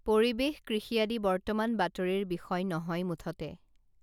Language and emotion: Assamese, neutral